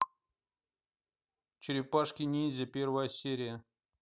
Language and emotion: Russian, neutral